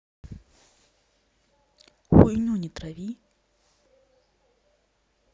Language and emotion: Russian, neutral